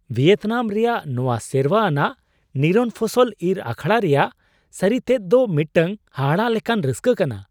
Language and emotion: Santali, surprised